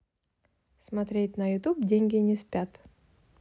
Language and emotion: Russian, positive